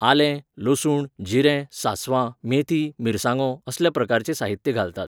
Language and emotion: Goan Konkani, neutral